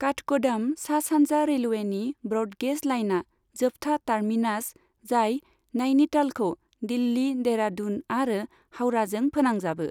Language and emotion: Bodo, neutral